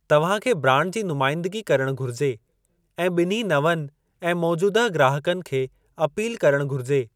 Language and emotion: Sindhi, neutral